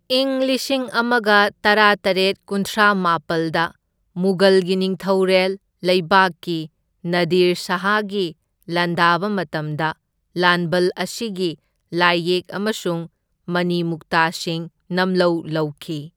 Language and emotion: Manipuri, neutral